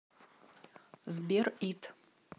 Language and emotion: Russian, neutral